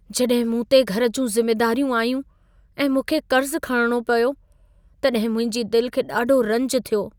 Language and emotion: Sindhi, sad